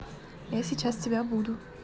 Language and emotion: Russian, neutral